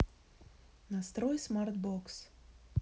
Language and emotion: Russian, neutral